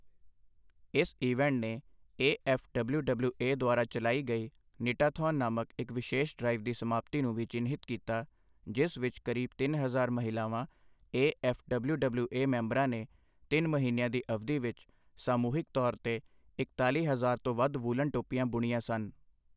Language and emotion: Punjabi, neutral